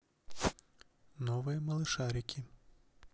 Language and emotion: Russian, neutral